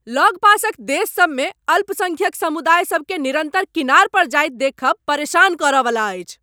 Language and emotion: Maithili, angry